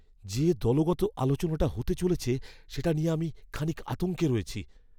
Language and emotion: Bengali, fearful